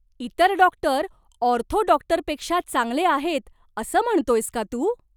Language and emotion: Marathi, surprised